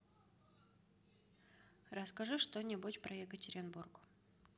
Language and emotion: Russian, neutral